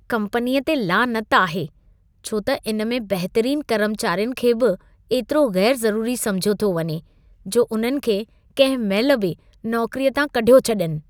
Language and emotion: Sindhi, disgusted